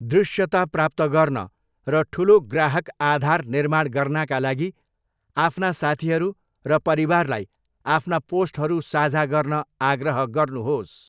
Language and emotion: Nepali, neutral